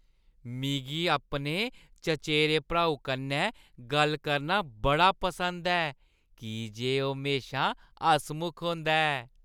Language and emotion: Dogri, happy